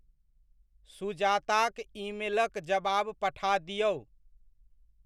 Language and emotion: Maithili, neutral